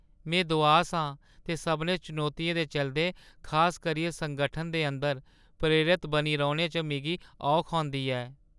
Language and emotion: Dogri, sad